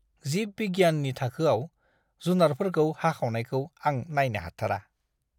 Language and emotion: Bodo, disgusted